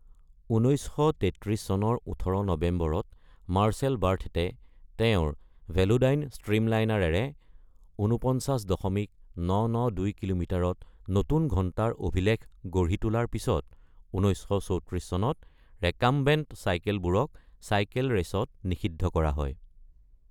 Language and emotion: Assamese, neutral